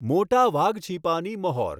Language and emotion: Gujarati, neutral